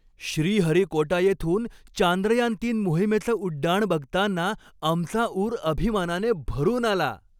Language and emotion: Marathi, happy